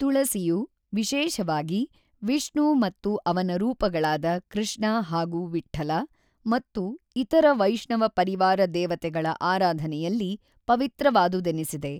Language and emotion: Kannada, neutral